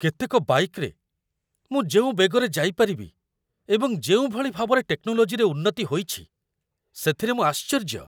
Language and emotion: Odia, surprised